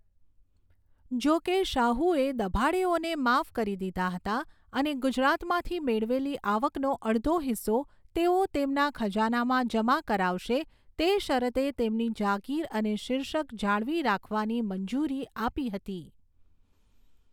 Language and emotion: Gujarati, neutral